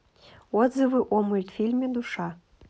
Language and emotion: Russian, neutral